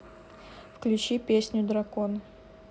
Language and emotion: Russian, neutral